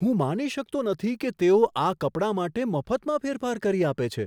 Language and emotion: Gujarati, surprised